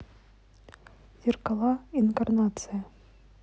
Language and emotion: Russian, neutral